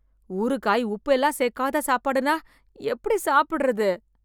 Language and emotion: Tamil, disgusted